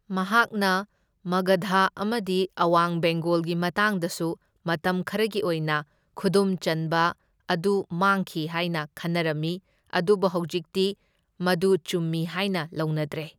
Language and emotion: Manipuri, neutral